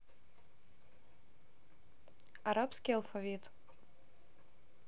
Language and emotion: Russian, neutral